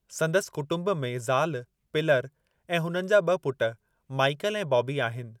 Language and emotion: Sindhi, neutral